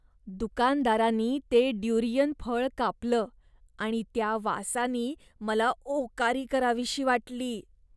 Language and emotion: Marathi, disgusted